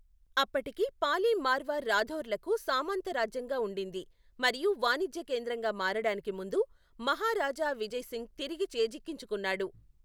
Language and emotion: Telugu, neutral